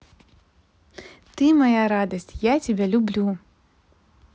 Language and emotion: Russian, positive